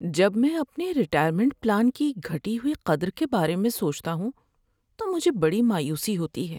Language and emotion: Urdu, sad